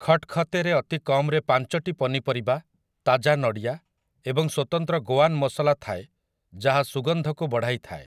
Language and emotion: Odia, neutral